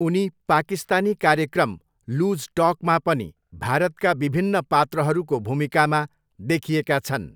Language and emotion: Nepali, neutral